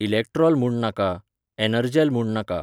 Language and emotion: Goan Konkani, neutral